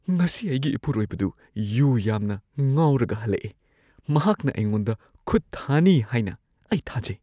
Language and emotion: Manipuri, fearful